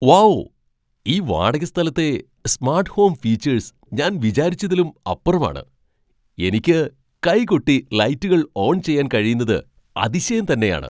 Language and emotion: Malayalam, surprised